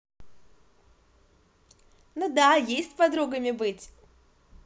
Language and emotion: Russian, positive